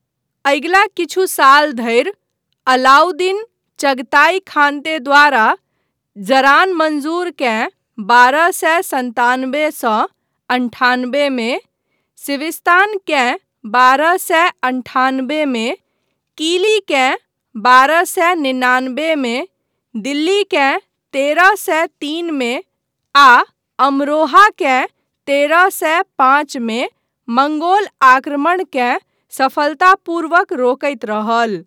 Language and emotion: Maithili, neutral